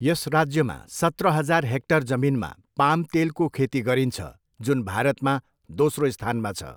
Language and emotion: Nepali, neutral